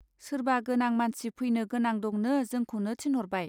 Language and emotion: Bodo, neutral